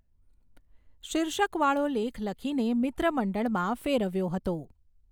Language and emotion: Gujarati, neutral